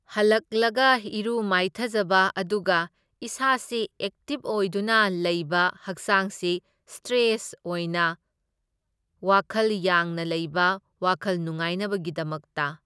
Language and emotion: Manipuri, neutral